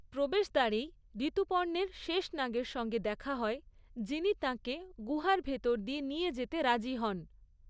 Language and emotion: Bengali, neutral